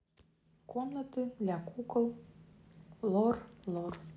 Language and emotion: Russian, neutral